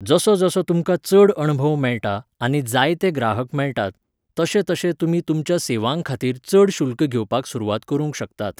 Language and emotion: Goan Konkani, neutral